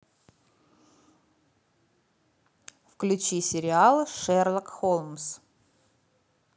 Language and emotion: Russian, neutral